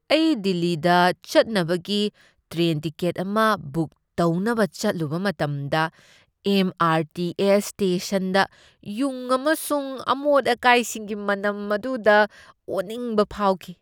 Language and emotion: Manipuri, disgusted